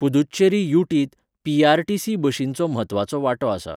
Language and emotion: Goan Konkani, neutral